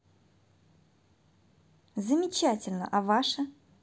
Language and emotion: Russian, positive